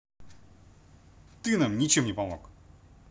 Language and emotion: Russian, angry